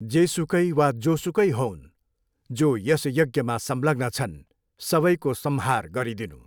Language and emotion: Nepali, neutral